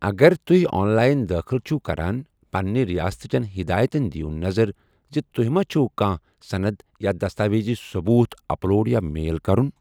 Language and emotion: Kashmiri, neutral